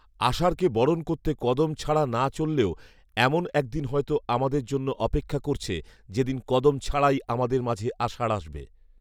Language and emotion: Bengali, neutral